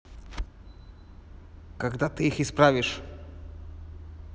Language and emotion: Russian, angry